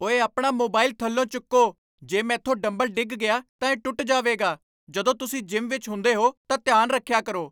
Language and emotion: Punjabi, angry